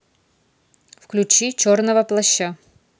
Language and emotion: Russian, neutral